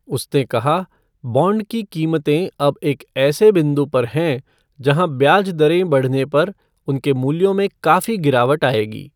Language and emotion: Hindi, neutral